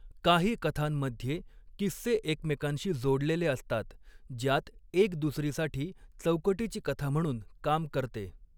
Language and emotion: Marathi, neutral